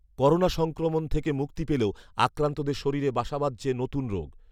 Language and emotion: Bengali, neutral